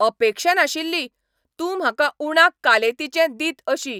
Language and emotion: Goan Konkani, angry